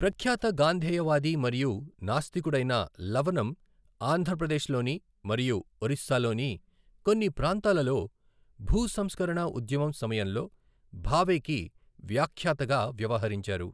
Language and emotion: Telugu, neutral